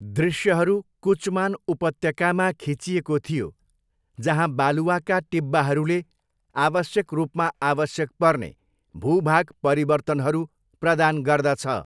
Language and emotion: Nepali, neutral